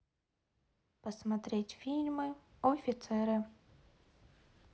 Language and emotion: Russian, neutral